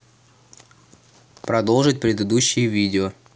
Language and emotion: Russian, neutral